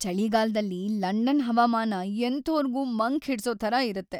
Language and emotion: Kannada, sad